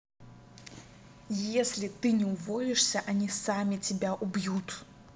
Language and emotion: Russian, angry